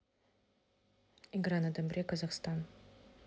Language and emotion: Russian, neutral